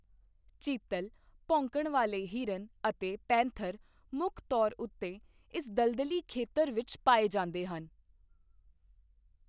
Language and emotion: Punjabi, neutral